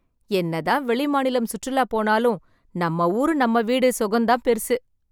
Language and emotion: Tamil, happy